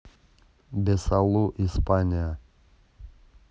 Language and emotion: Russian, neutral